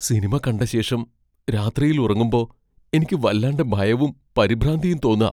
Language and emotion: Malayalam, fearful